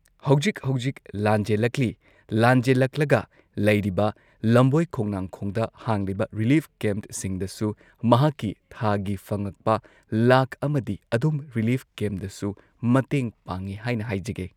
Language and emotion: Manipuri, neutral